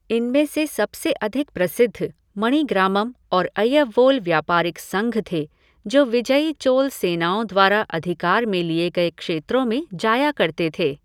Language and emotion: Hindi, neutral